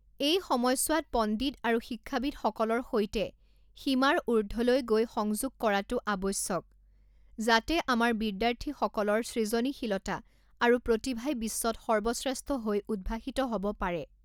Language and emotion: Assamese, neutral